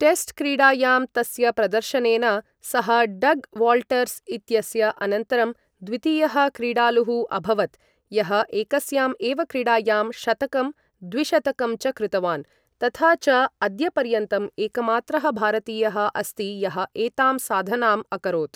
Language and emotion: Sanskrit, neutral